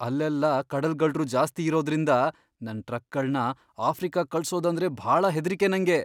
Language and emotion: Kannada, fearful